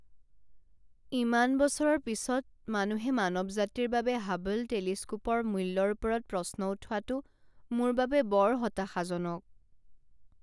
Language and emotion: Assamese, sad